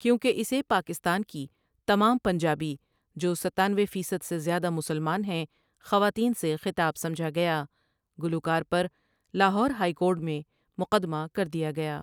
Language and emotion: Urdu, neutral